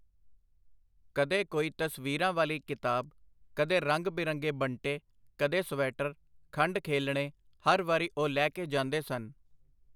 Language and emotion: Punjabi, neutral